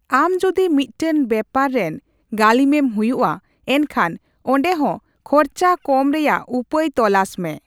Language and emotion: Santali, neutral